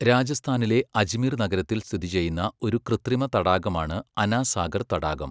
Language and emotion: Malayalam, neutral